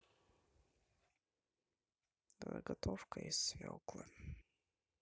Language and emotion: Russian, sad